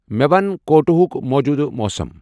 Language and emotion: Kashmiri, neutral